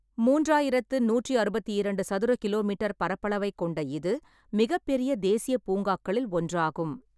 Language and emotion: Tamil, neutral